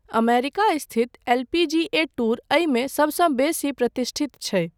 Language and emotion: Maithili, neutral